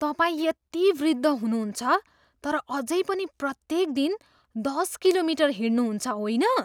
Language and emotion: Nepali, surprised